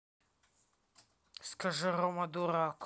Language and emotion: Russian, angry